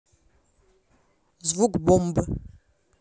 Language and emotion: Russian, neutral